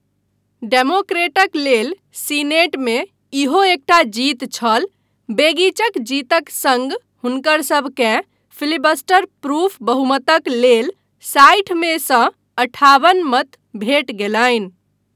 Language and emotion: Maithili, neutral